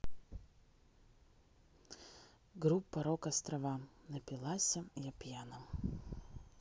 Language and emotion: Russian, neutral